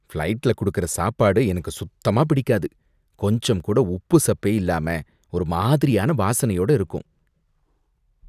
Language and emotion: Tamil, disgusted